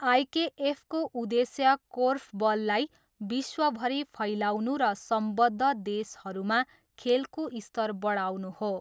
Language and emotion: Nepali, neutral